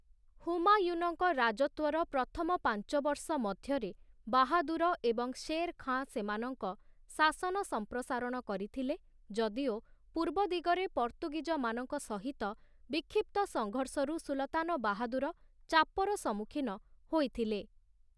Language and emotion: Odia, neutral